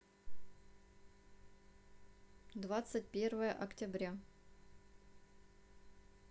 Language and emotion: Russian, neutral